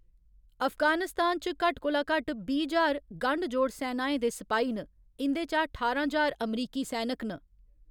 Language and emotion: Dogri, neutral